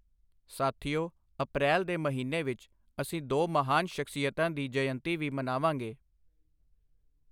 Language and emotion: Punjabi, neutral